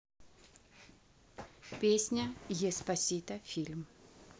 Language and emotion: Russian, neutral